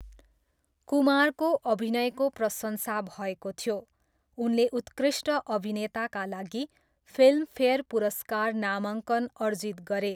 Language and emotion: Nepali, neutral